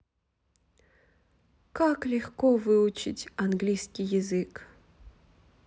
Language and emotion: Russian, sad